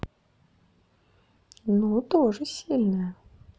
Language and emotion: Russian, neutral